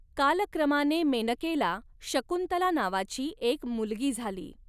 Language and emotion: Marathi, neutral